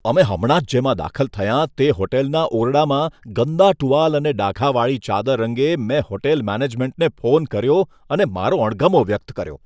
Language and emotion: Gujarati, disgusted